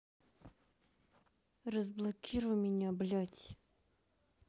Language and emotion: Russian, angry